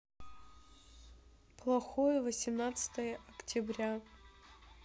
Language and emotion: Russian, sad